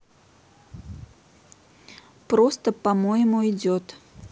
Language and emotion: Russian, neutral